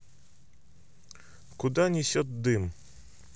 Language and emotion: Russian, neutral